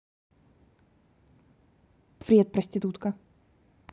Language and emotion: Russian, angry